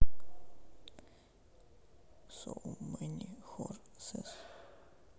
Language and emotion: Russian, sad